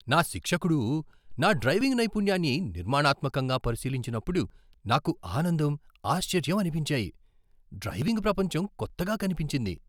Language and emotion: Telugu, surprised